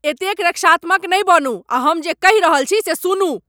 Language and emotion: Maithili, angry